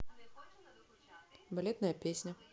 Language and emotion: Russian, neutral